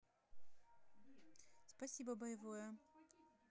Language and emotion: Russian, neutral